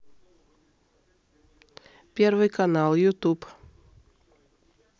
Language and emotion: Russian, neutral